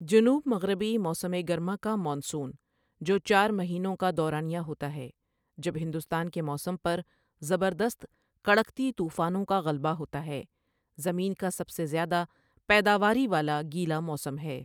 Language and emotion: Urdu, neutral